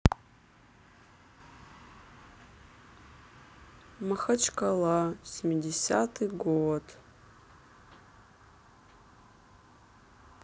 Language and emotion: Russian, sad